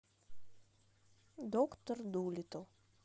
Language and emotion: Russian, neutral